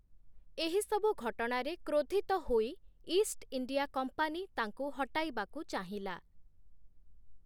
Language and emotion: Odia, neutral